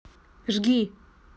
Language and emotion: Russian, neutral